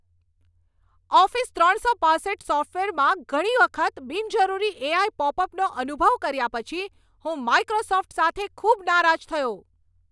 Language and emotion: Gujarati, angry